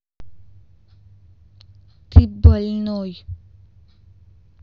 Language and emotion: Russian, angry